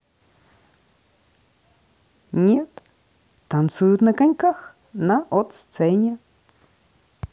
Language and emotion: Russian, positive